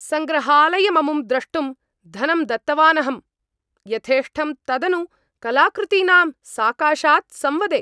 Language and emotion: Sanskrit, angry